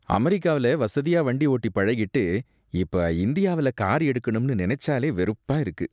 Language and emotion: Tamil, disgusted